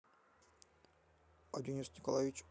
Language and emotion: Russian, neutral